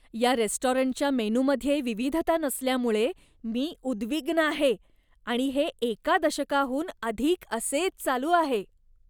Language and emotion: Marathi, disgusted